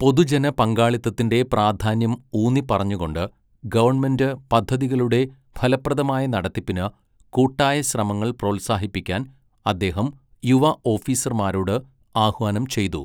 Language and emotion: Malayalam, neutral